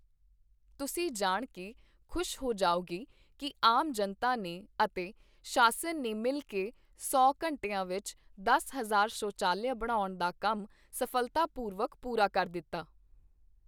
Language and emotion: Punjabi, neutral